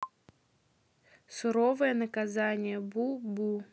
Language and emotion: Russian, neutral